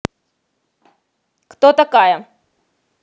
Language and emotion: Russian, angry